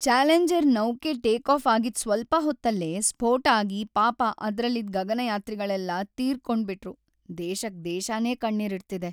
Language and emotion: Kannada, sad